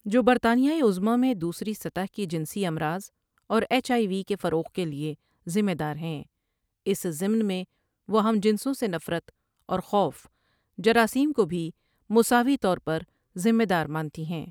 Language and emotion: Urdu, neutral